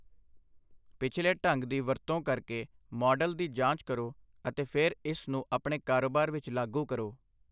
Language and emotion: Punjabi, neutral